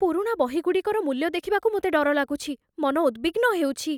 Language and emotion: Odia, fearful